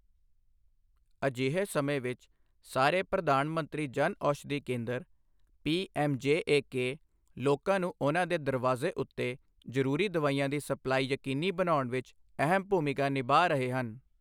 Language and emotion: Punjabi, neutral